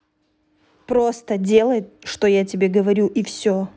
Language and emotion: Russian, angry